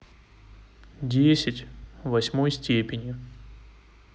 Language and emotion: Russian, neutral